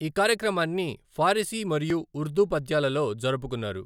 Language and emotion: Telugu, neutral